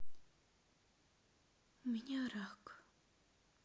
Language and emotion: Russian, sad